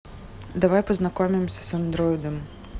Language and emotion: Russian, neutral